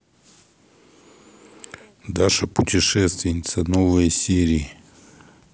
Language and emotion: Russian, neutral